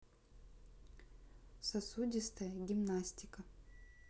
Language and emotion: Russian, neutral